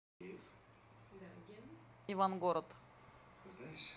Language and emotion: Russian, neutral